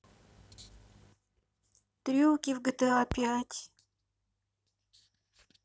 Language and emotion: Russian, sad